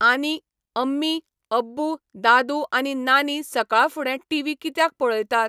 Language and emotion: Goan Konkani, neutral